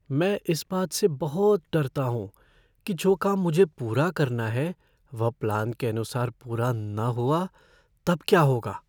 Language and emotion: Hindi, fearful